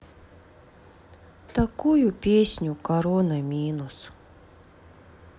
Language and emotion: Russian, sad